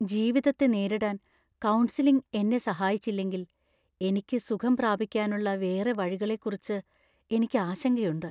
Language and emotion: Malayalam, fearful